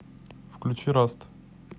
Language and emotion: Russian, neutral